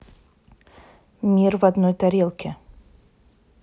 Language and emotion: Russian, neutral